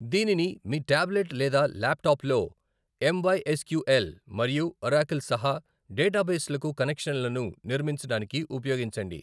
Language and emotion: Telugu, neutral